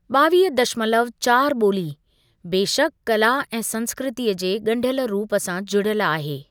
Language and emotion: Sindhi, neutral